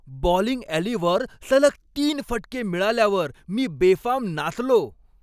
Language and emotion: Marathi, happy